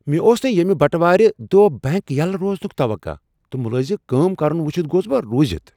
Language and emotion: Kashmiri, surprised